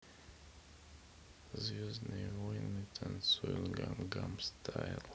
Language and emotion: Russian, neutral